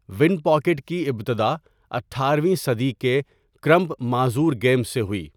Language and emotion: Urdu, neutral